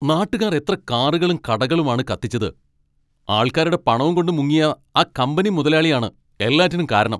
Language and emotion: Malayalam, angry